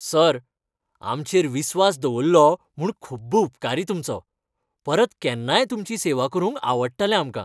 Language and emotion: Goan Konkani, happy